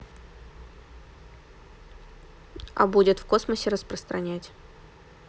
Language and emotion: Russian, neutral